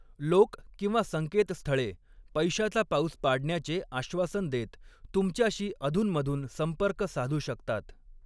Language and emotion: Marathi, neutral